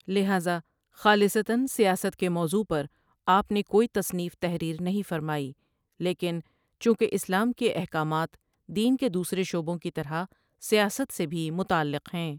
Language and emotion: Urdu, neutral